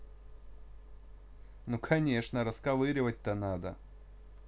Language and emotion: Russian, positive